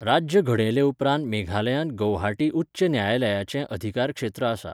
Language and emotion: Goan Konkani, neutral